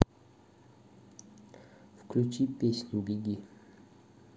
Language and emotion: Russian, neutral